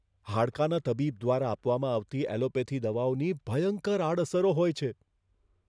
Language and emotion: Gujarati, fearful